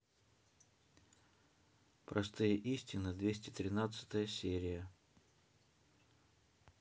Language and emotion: Russian, neutral